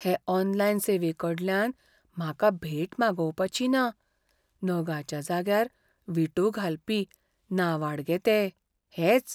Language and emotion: Goan Konkani, fearful